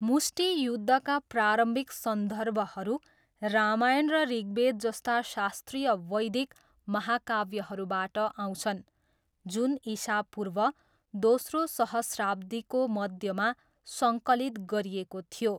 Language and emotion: Nepali, neutral